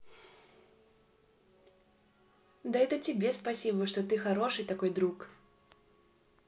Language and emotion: Russian, positive